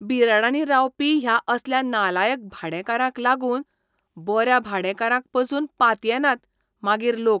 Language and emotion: Goan Konkani, disgusted